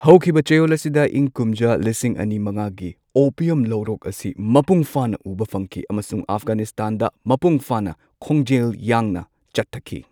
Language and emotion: Manipuri, neutral